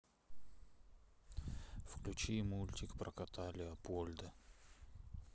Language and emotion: Russian, sad